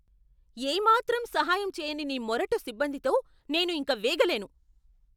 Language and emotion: Telugu, angry